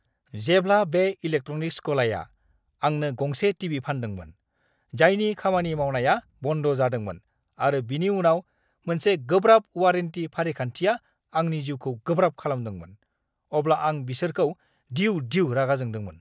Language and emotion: Bodo, angry